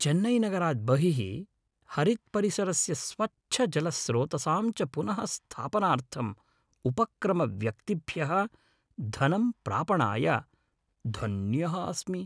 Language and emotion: Sanskrit, happy